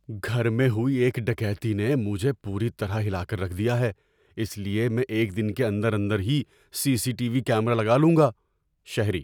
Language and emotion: Urdu, fearful